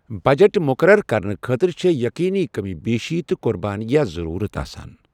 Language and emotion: Kashmiri, neutral